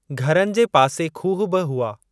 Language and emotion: Sindhi, neutral